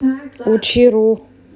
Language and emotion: Russian, neutral